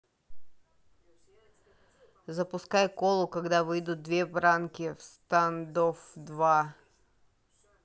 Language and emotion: Russian, neutral